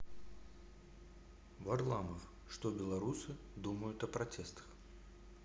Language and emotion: Russian, neutral